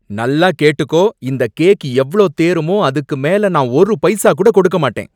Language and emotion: Tamil, angry